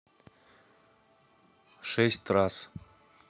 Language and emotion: Russian, neutral